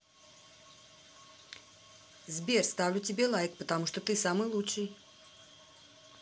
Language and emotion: Russian, positive